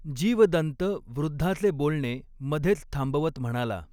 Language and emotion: Marathi, neutral